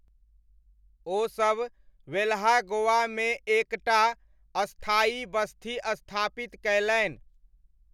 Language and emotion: Maithili, neutral